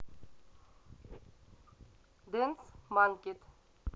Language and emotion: Russian, neutral